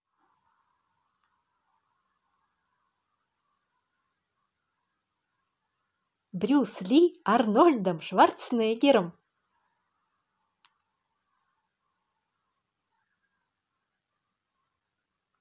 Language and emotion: Russian, positive